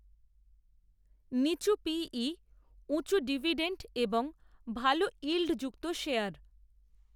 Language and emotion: Bengali, neutral